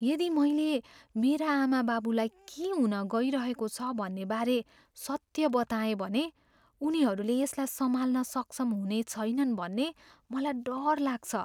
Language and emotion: Nepali, fearful